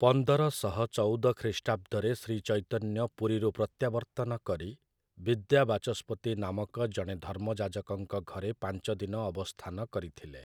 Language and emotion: Odia, neutral